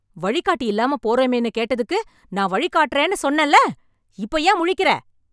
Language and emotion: Tamil, angry